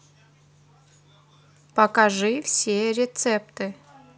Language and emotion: Russian, neutral